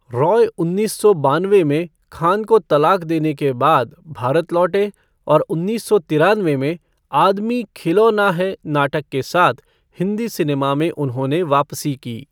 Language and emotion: Hindi, neutral